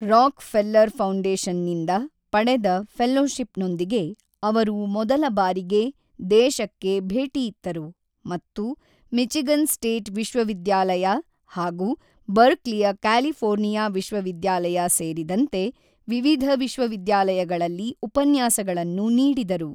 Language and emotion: Kannada, neutral